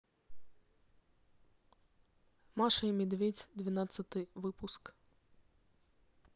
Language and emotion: Russian, neutral